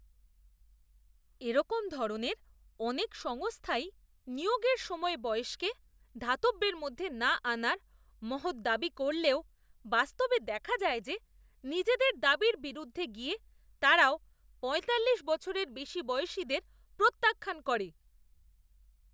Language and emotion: Bengali, disgusted